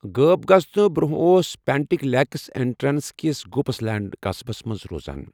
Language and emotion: Kashmiri, neutral